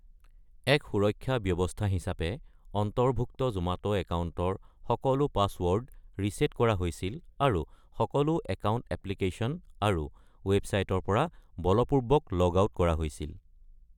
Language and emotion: Assamese, neutral